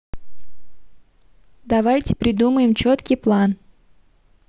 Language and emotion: Russian, neutral